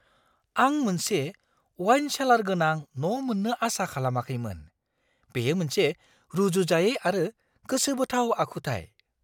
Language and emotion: Bodo, surprised